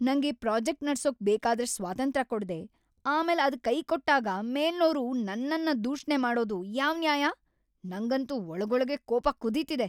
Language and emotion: Kannada, angry